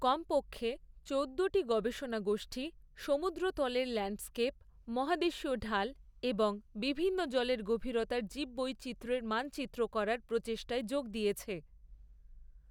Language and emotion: Bengali, neutral